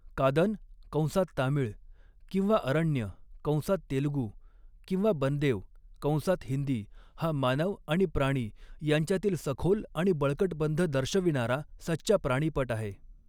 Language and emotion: Marathi, neutral